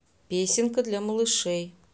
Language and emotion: Russian, neutral